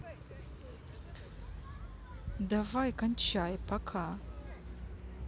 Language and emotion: Russian, neutral